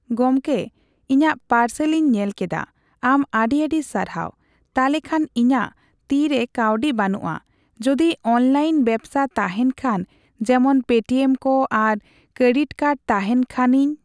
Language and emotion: Santali, neutral